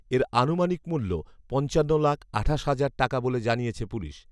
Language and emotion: Bengali, neutral